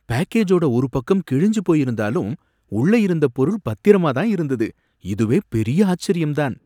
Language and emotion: Tamil, surprised